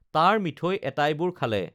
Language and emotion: Assamese, neutral